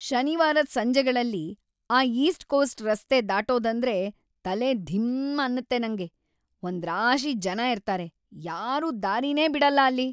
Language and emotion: Kannada, angry